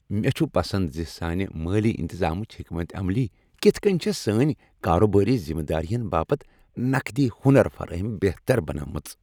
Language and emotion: Kashmiri, happy